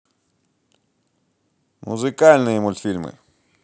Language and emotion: Russian, positive